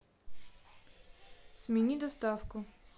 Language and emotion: Russian, neutral